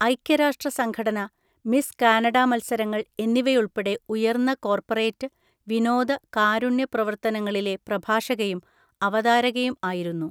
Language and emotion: Malayalam, neutral